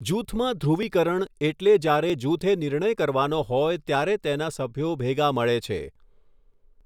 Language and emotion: Gujarati, neutral